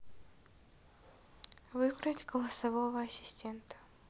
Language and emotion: Russian, neutral